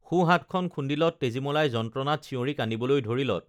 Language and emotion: Assamese, neutral